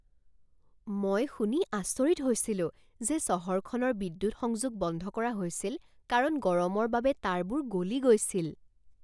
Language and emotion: Assamese, surprised